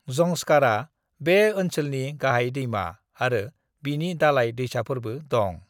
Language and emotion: Bodo, neutral